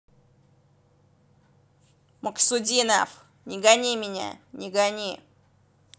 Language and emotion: Russian, angry